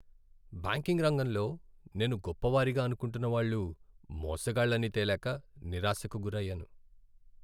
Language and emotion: Telugu, sad